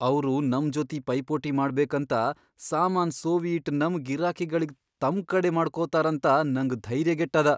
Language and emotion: Kannada, fearful